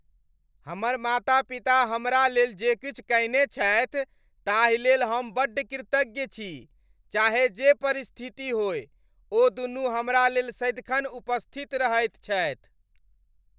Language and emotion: Maithili, happy